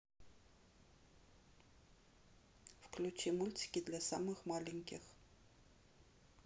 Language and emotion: Russian, neutral